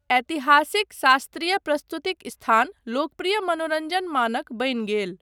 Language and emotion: Maithili, neutral